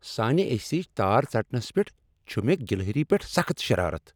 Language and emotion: Kashmiri, angry